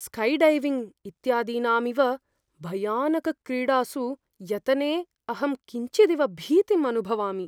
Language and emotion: Sanskrit, fearful